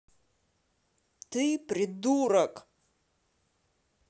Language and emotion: Russian, angry